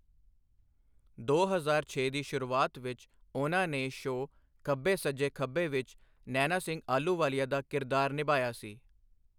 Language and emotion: Punjabi, neutral